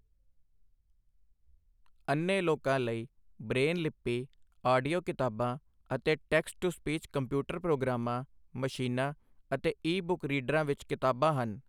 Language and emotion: Punjabi, neutral